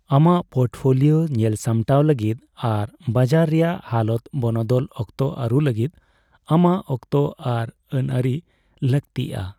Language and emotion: Santali, neutral